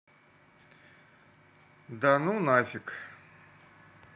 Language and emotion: Russian, neutral